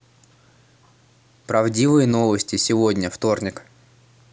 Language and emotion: Russian, neutral